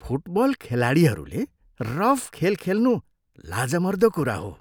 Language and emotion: Nepali, disgusted